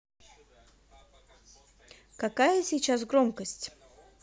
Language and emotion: Russian, neutral